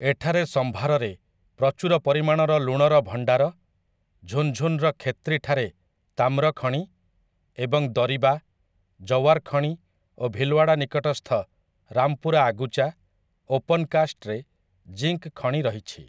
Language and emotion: Odia, neutral